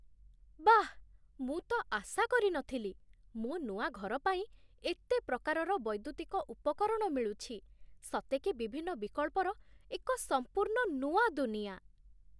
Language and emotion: Odia, surprised